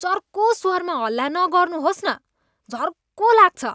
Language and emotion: Nepali, disgusted